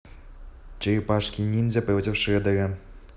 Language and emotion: Russian, neutral